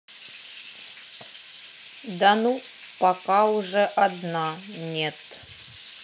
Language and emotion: Russian, neutral